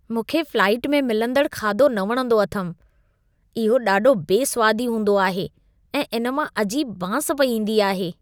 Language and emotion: Sindhi, disgusted